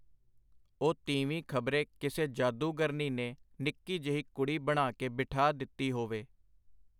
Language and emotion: Punjabi, neutral